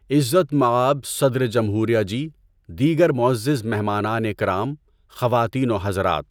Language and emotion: Urdu, neutral